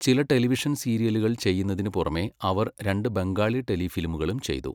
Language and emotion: Malayalam, neutral